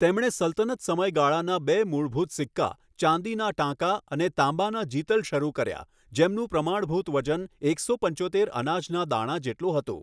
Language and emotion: Gujarati, neutral